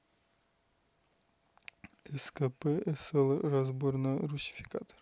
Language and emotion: Russian, neutral